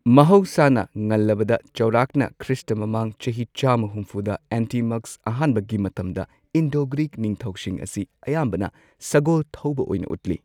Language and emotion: Manipuri, neutral